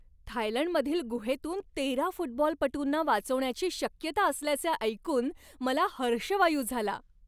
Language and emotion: Marathi, happy